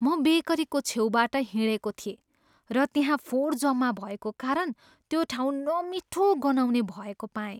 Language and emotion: Nepali, disgusted